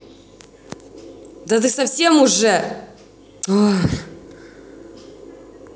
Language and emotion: Russian, angry